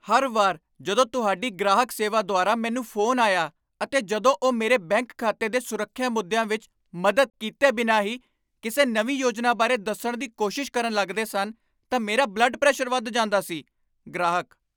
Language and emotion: Punjabi, angry